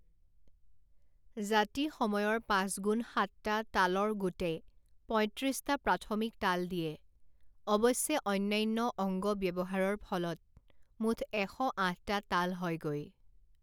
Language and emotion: Assamese, neutral